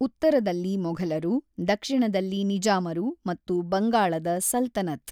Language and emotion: Kannada, neutral